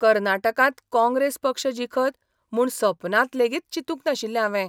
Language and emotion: Goan Konkani, surprised